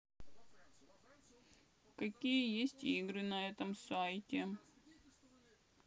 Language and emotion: Russian, sad